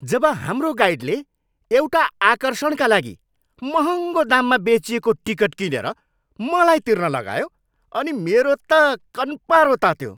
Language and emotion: Nepali, angry